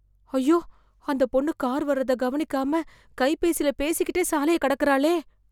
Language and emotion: Tamil, fearful